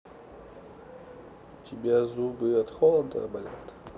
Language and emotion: Russian, neutral